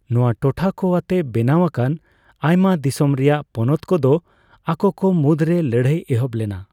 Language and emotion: Santali, neutral